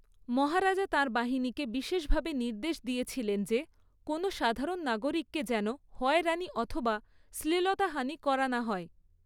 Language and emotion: Bengali, neutral